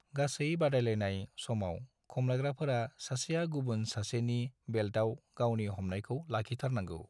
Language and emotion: Bodo, neutral